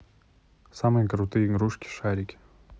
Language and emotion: Russian, neutral